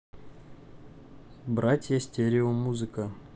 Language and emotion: Russian, neutral